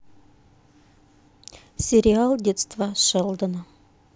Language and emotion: Russian, neutral